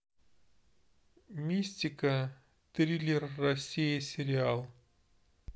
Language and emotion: Russian, neutral